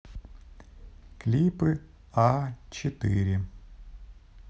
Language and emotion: Russian, neutral